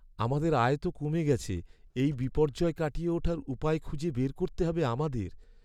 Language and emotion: Bengali, sad